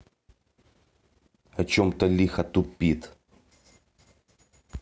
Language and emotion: Russian, angry